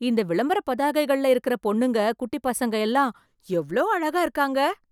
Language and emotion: Tamil, surprised